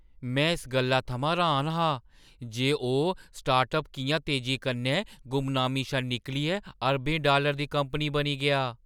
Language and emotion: Dogri, surprised